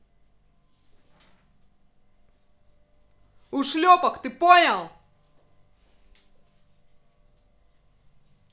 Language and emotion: Russian, angry